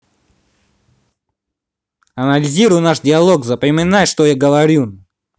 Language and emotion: Russian, angry